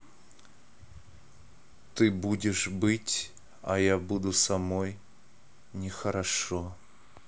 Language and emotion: Russian, neutral